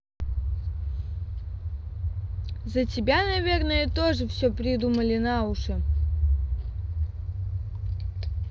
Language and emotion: Russian, neutral